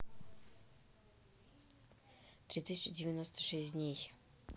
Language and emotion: Russian, neutral